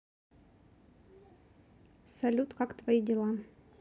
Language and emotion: Russian, neutral